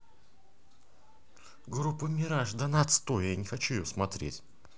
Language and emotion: Russian, angry